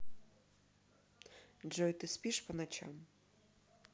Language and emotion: Russian, neutral